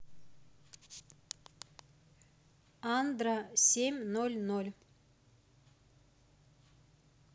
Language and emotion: Russian, neutral